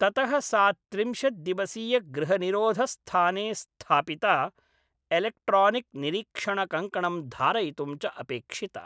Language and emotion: Sanskrit, neutral